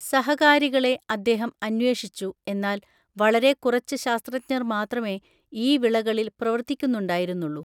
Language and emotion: Malayalam, neutral